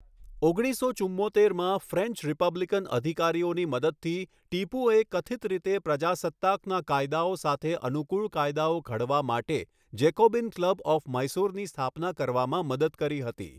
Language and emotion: Gujarati, neutral